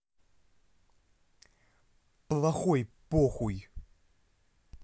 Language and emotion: Russian, angry